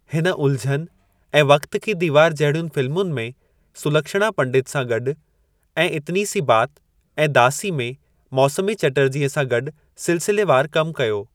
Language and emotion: Sindhi, neutral